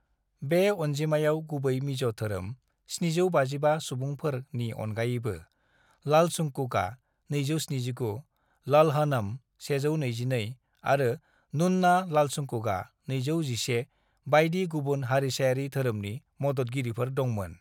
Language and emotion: Bodo, neutral